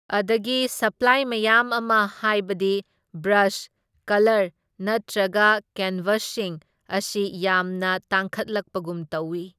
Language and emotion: Manipuri, neutral